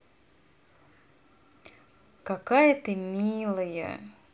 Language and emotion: Russian, positive